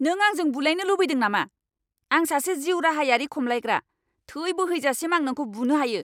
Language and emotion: Bodo, angry